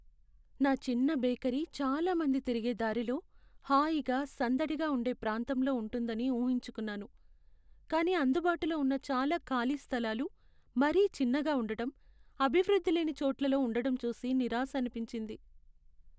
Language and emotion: Telugu, sad